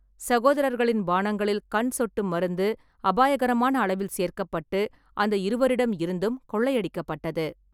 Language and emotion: Tamil, neutral